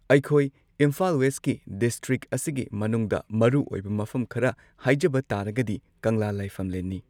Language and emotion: Manipuri, neutral